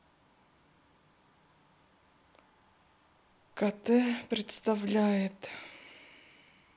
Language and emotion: Russian, sad